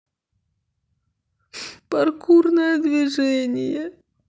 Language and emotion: Russian, sad